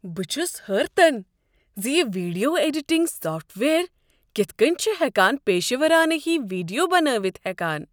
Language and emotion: Kashmiri, surprised